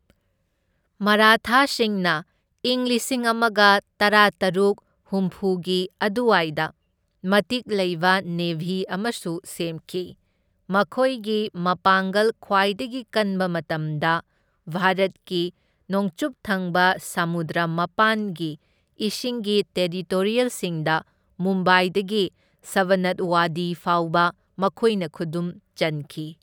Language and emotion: Manipuri, neutral